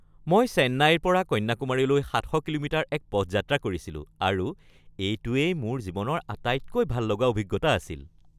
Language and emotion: Assamese, happy